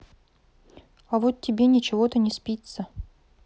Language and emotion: Russian, neutral